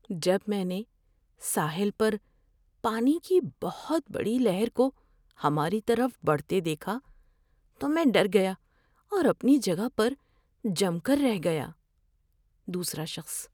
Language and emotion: Urdu, fearful